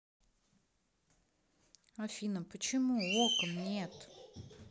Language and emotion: Russian, sad